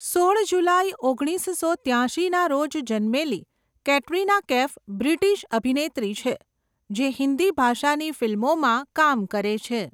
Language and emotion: Gujarati, neutral